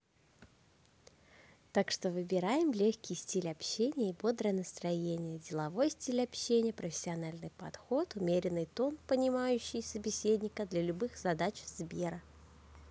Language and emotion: Russian, neutral